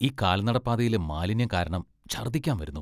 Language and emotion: Malayalam, disgusted